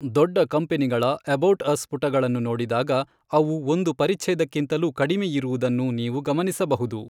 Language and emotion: Kannada, neutral